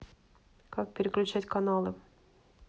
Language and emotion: Russian, neutral